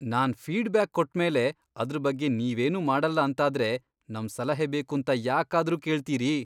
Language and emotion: Kannada, disgusted